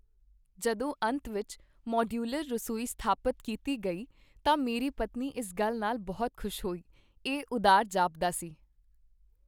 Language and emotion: Punjabi, happy